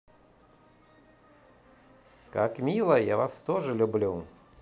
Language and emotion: Russian, positive